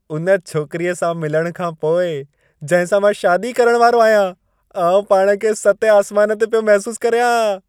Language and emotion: Sindhi, happy